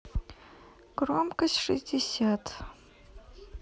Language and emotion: Russian, neutral